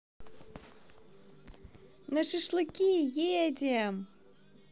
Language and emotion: Russian, positive